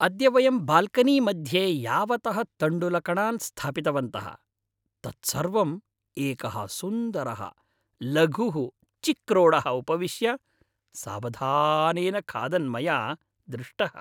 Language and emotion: Sanskrit, happy